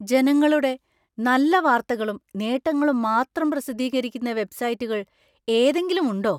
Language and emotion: Malayalam, surprised